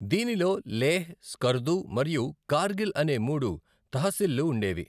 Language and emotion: Telugu, neutral